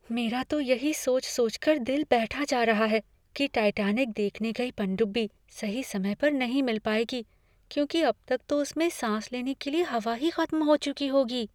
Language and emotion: Hindi, fearful